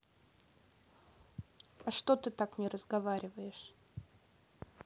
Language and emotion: Russian, neutral